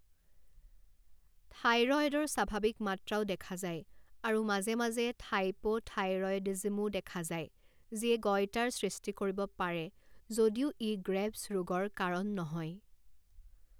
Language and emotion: Assamese, neutral